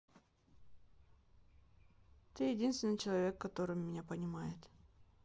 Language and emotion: Russian, sad